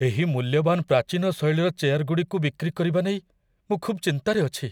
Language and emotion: Odia, fearful